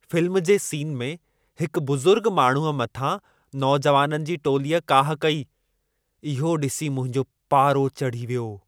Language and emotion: Sindhi, angry